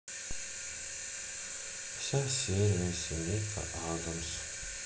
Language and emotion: Russian, sad